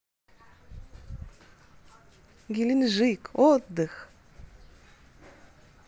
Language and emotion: Russian, positive